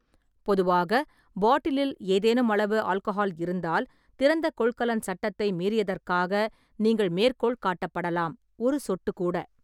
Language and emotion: Tamil, neutral